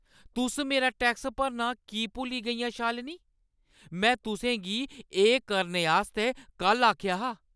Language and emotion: Dogri, angry